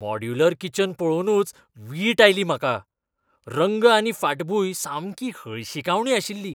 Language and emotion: Goan Konkani, disgusted